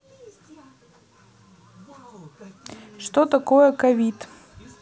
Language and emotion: Russian, neutral